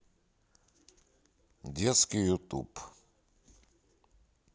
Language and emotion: Russian, neutral